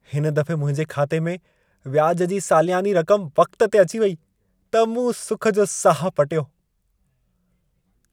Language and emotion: Sindhi, happy